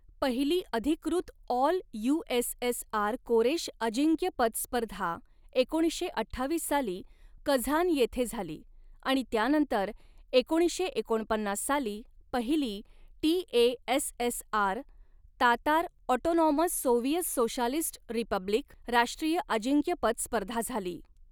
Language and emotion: Marathi, neutral